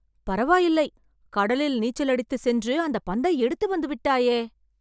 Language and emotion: Tamil, surprised